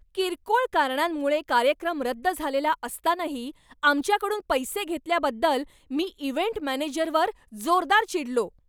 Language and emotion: Marathi, angry